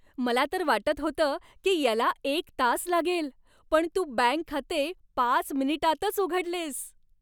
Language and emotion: Marathi, happy